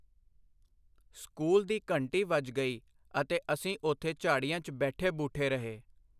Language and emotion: Punjabi, neutral